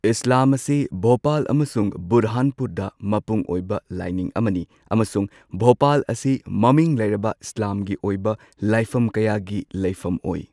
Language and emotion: Manipuri, neutral